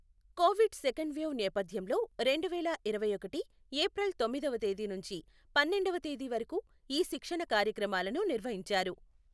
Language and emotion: Telugu, neutral